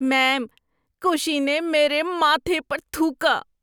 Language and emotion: Urdu, disgusted